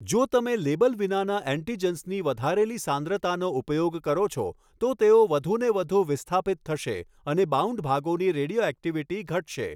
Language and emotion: Gujarati, neutral